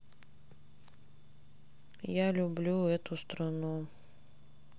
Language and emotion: Russian, sad